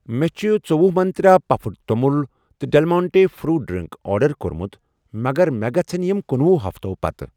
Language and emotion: Kashmiri, neutral